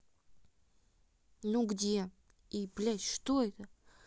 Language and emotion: Russian, angry